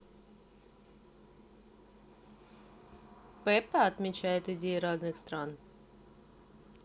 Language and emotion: Russian, neutral